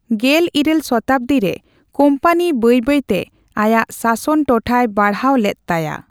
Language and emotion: Santali, neutral